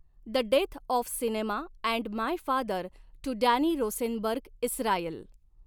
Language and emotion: Marathi, neutral